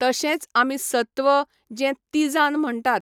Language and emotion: Goan Konkani, neutral